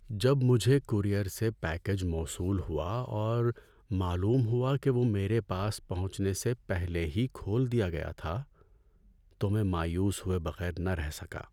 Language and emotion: Urdu, sad